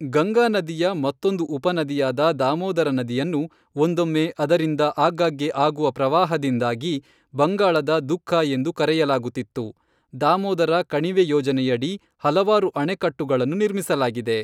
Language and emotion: Kannada, neutral